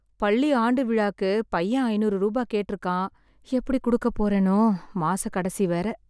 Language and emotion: Tamil, sad